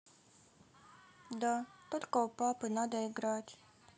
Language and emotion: Russian, sad